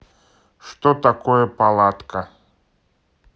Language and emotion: Russian, neutral